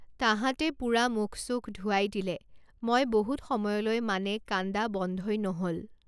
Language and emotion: Assamese, neutral